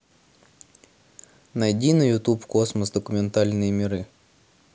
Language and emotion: Russian, neutral